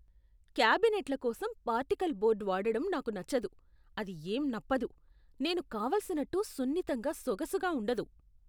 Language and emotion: Telugu, disgusted